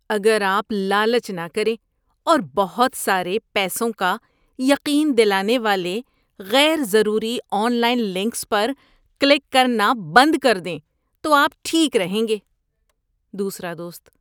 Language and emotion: Urdu, disgusted